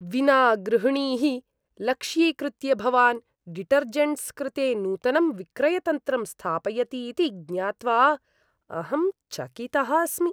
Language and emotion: Sanskrit, disgusted